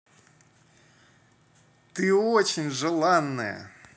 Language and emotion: Russian, positive